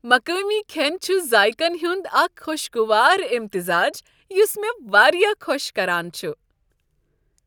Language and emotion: Kashmiri, happy